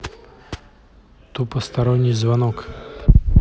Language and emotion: Russian, neutral